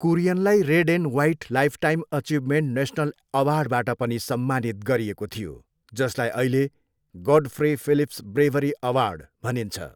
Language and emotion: Nepali, neutral